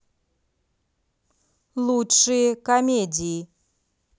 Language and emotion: Russian, neutral